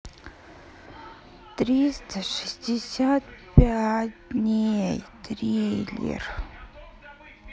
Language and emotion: Russian, sad